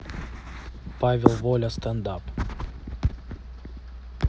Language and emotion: Russian, neutral